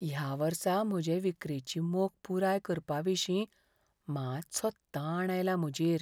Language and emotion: Goan Konkani, fearful